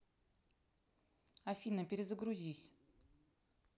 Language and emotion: Russian, neutral